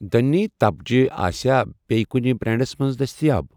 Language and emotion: Kashmiri, neutral